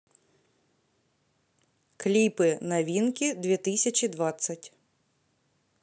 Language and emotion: Russian, neutral